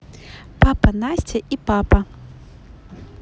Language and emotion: Russian, positive